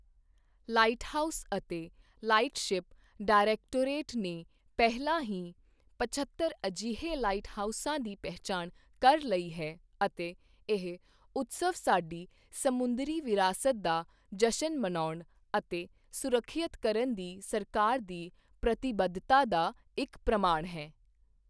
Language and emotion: Punjabi, neutral